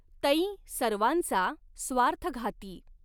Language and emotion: Marathi, neutral